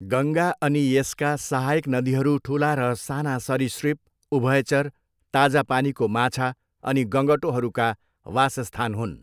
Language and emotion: Nepali, neutral